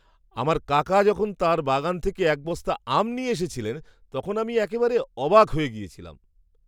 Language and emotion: Bengali, surprised